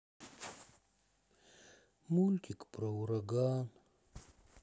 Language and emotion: Russian, sad